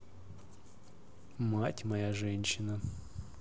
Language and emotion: Russian, neutral